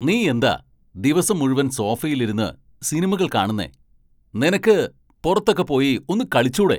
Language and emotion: Malayalam, angry